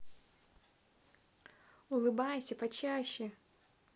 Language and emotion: Russian, positive